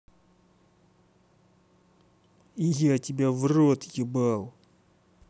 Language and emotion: Russian, angry